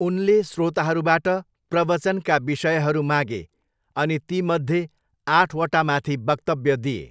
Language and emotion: Nepali, neutral